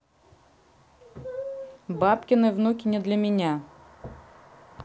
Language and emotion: Russian, neutral